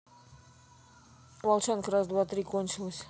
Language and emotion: Russian, neutral